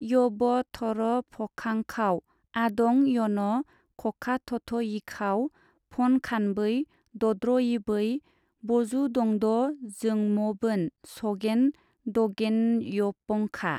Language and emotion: Bodo, neutral